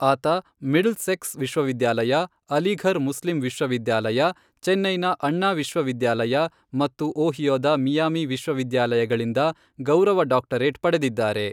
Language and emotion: Kannada, neutral